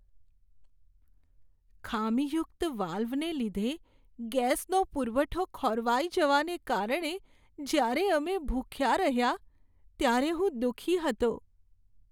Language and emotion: Gujarati, sad